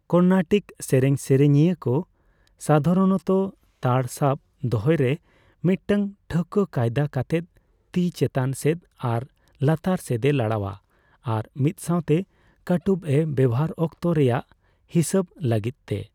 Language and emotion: Santali, neutral